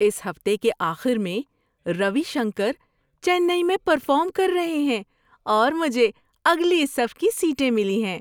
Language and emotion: Urdu, happy